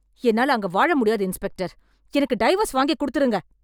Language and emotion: Tamil, angry